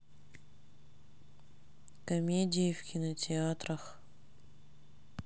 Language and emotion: Russian, sad